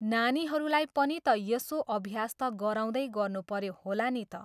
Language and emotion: Nepali, neutral